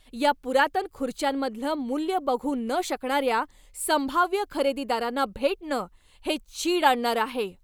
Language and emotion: Marathi, angry